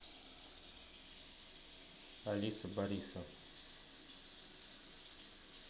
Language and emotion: Russian, neutral